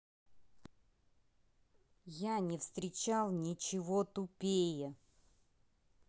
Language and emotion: Russian, angry